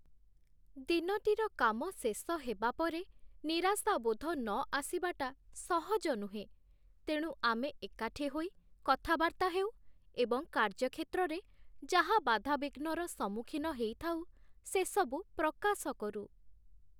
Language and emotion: Odia, sad